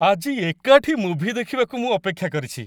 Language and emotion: Odia, happy